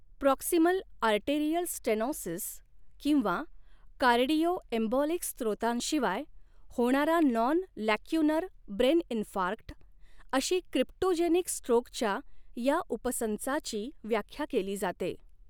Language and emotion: Marathi, neutral